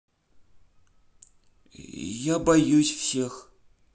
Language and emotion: Russian, neutral